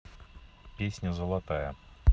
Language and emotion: Russian, neutral